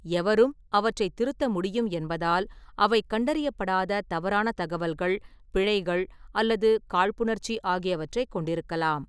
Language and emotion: Tamil, neutral